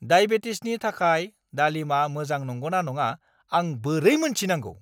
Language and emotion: Bodo, angry